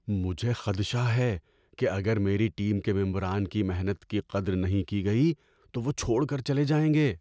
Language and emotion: Urdu, fearful